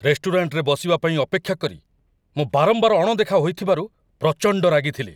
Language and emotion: Odia, angry